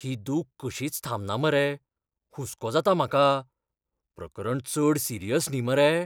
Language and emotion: Goan Konkani, fearful